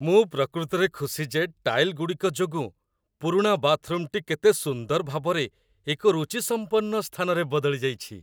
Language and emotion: Odia, happy